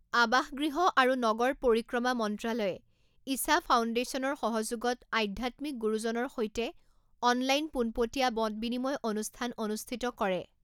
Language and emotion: Assamese, neutral